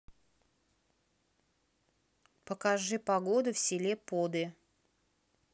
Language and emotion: Russian, neutral